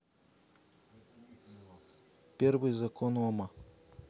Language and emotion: Russian, neutral